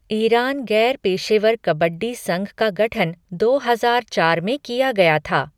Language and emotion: Hindi, neutral